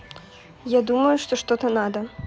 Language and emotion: Russian, neutral